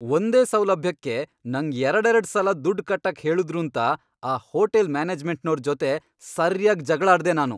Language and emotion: Kannada, angry